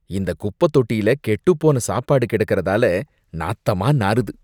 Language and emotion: Tamil, disgusted